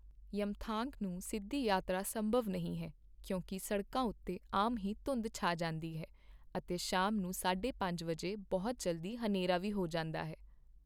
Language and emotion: Punjabi, neutral